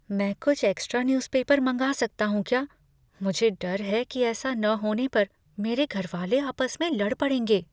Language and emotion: Hindi, fearful